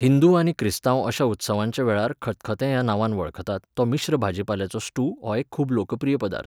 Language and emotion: Goan Konkani, neutral